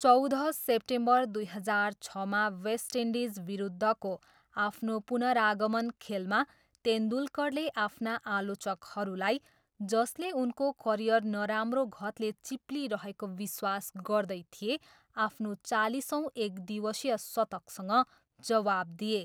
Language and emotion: Nepali, neutral